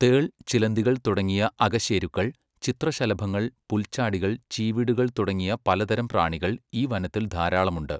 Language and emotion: Malayalam, neutral